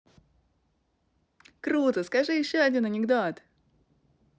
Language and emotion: Russian, positive